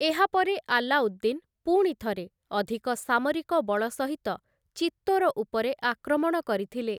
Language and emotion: Odia, neutral